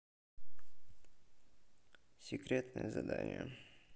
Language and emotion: Russian, neutral